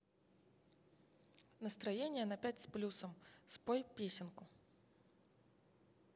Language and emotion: Russian, neutral